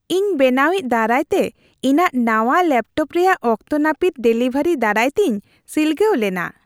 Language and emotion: Santali, happy